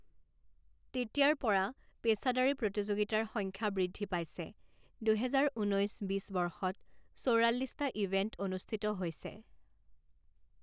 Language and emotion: Assamese, neutral